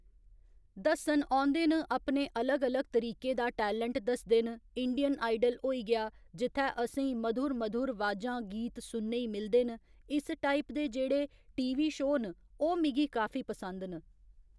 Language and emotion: Dogri, neutral